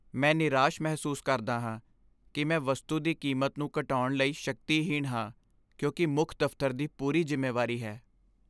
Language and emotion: Punjabi, sad